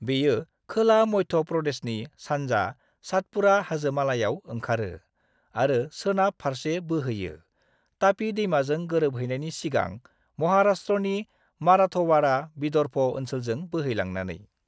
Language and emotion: Bodo, neutral